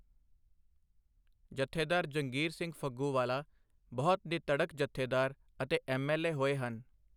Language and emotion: Punjabi, neutral